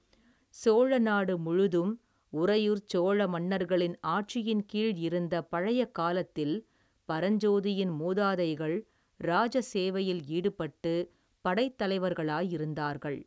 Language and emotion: Tamil, neutral